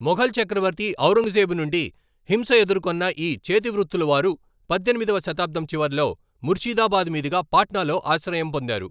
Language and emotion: Telugu, neutral